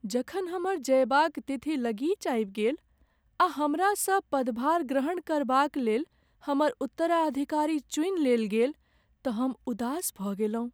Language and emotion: Maithili, sad